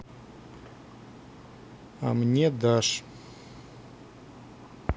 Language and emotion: Russian, neutral